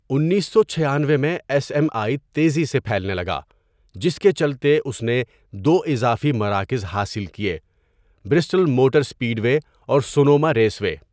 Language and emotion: Urdu, neutral